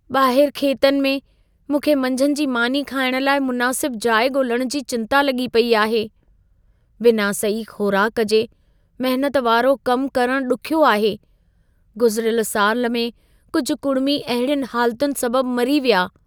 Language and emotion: Sindhi, fearful